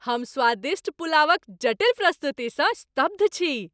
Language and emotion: Maithili, happy